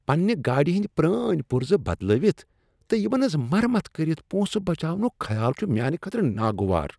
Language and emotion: Kashmiri, disgusted